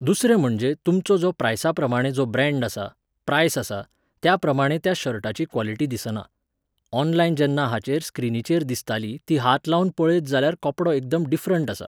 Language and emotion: Goan Konkani, neutral